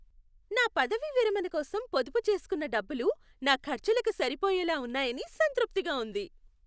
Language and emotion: Telugu, happy